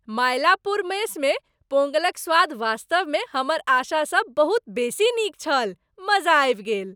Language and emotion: Maithili, happy